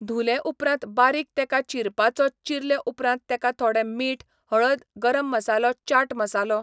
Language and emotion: Goan Konkani, neutral